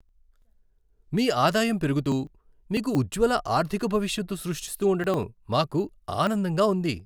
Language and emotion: Telugu, happy